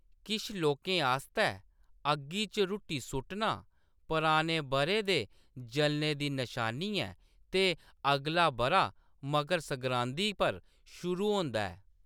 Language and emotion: Dogri, neutral